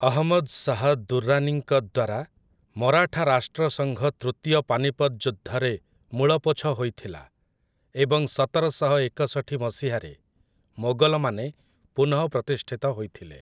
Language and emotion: Odia, neutral